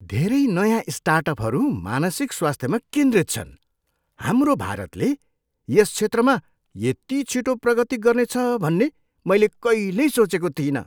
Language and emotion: Nepali, surprised